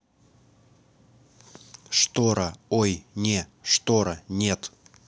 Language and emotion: Russian, neutral